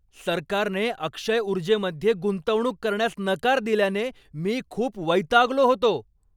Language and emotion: Marathi, angry